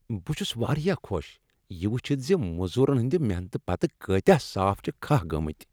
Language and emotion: Kashmiri, happy